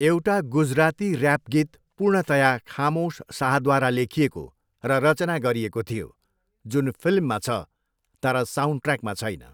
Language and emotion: Nepali, neutral